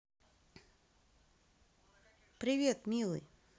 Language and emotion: Russian, positive